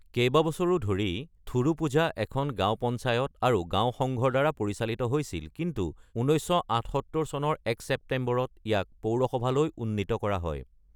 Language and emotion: Assamese, neutral